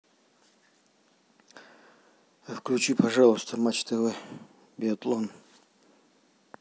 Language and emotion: Russian, neutral